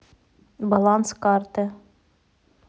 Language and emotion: Russian, neutral